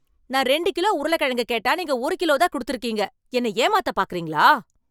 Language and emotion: Tamil, angry